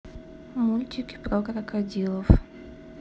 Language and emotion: Russian, neutral